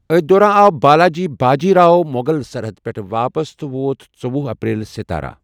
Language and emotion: Kashmiri, neutral